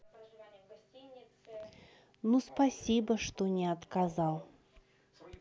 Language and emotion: Russian, neutral